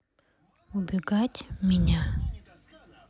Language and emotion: Russian, neutral